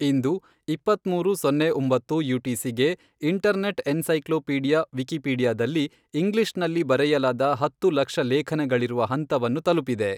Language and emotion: Kannada, neutral